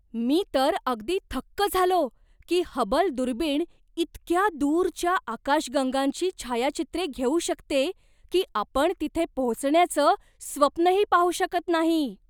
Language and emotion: Marathi, surprised